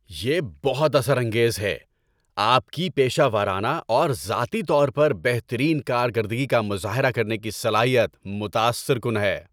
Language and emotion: Urdu, happy